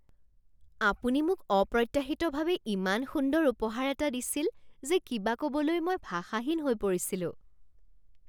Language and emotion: Assamese, surprised